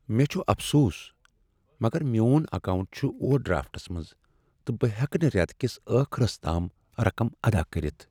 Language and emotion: Kashmiri, sad